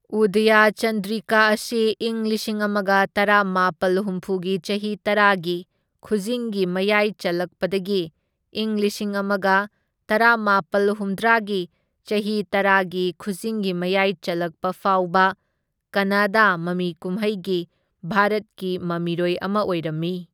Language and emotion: Manipuri, neutral